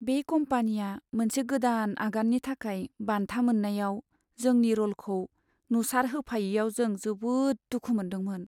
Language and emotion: Bodo, sad